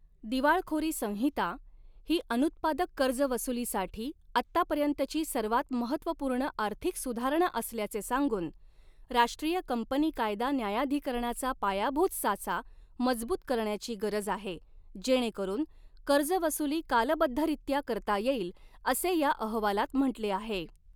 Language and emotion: Marathi, neutral